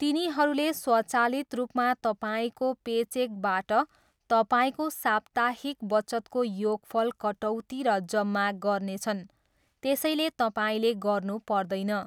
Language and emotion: Nepali, neutral